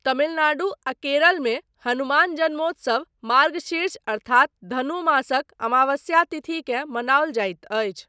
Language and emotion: Maithili, neutral